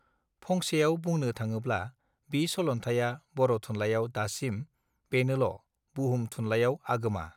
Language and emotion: Bodo, neutral